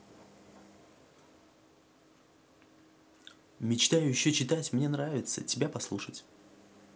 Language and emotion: Russian, neutral